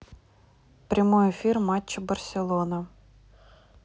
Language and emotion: Russian, neutral